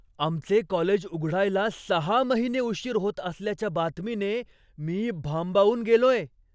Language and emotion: Marathi, surprised